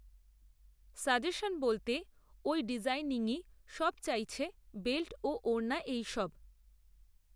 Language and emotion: Bengali, neutral